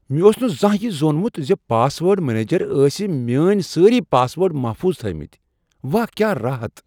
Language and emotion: Kashmiri, surprised